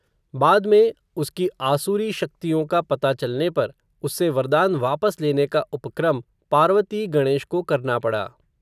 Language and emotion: Hindi, neutral